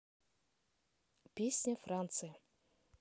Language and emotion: Russian, neutral